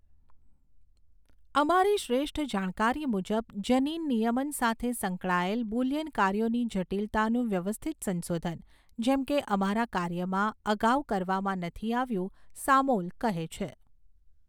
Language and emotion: Gujarati, neutral